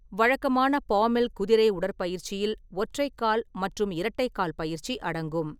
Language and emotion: Tamil, neutral